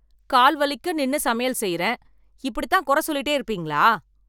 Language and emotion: Tamil, angry